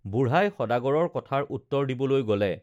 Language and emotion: Assamese, neutral